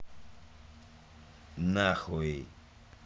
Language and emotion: Russian, neutral